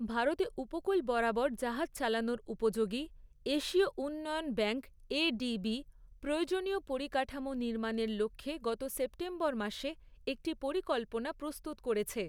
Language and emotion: Bengali, neutral